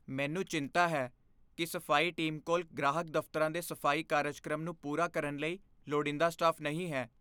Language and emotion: Punjabi, fearful